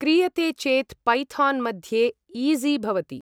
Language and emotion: Sanskrit, neutral